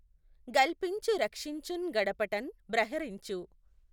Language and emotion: Telugu, neutral